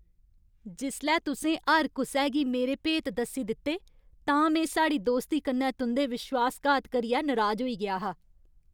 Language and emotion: Dogri, angry